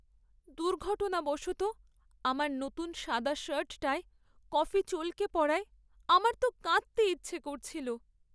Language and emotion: Bengali, sad